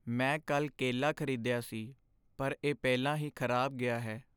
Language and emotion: Punjabi, sad